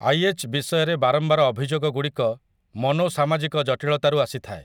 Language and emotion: Odia, neutral